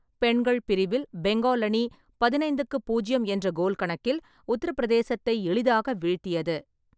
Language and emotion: Tamil, neutral